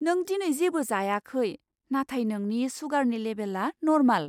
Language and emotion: Bodo, surprised